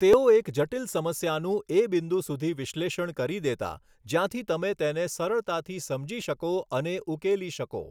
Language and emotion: Gujarati, neutral